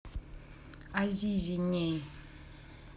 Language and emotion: Russian, neutral